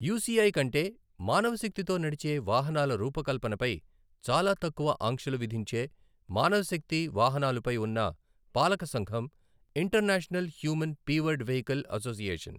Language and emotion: Telugu, neutral